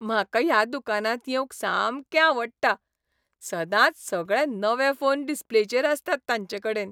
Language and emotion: Goan Konkani, happy